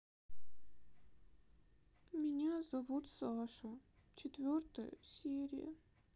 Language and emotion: Russian, sad